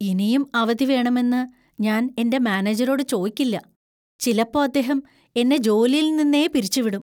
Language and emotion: Malayalam, fearful